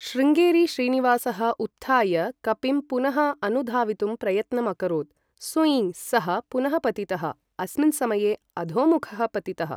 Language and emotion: Sanskrit, neutral